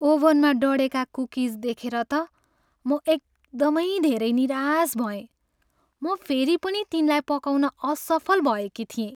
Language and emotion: Nepali, sad